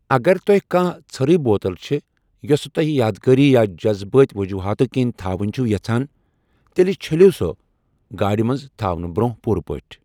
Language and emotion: Kashmiri, neutral